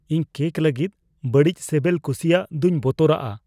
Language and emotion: Santali, fearful